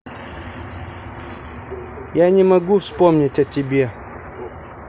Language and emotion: Russian, neutral